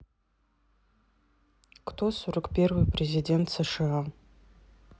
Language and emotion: Russian, neutral